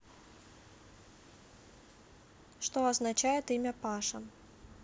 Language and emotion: Russian, neutral